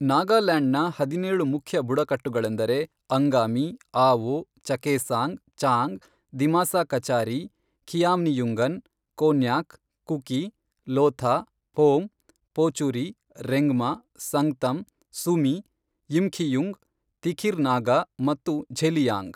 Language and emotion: Kannada, neutral